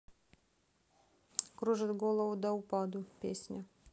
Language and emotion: Russian, neutral